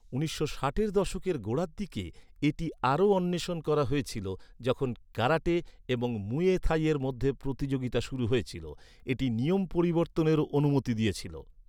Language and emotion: Bengali, neutral